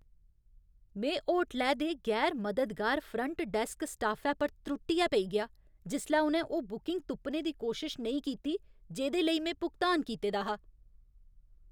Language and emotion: Dogri, angry